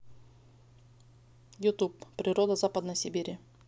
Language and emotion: Russian, neutral